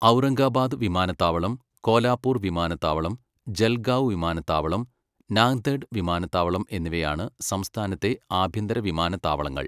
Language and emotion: Malayalam, neutral